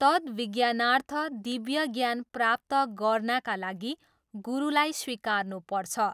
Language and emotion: Nepali, neutral